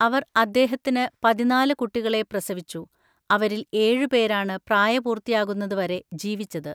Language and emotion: Malayalam, neutral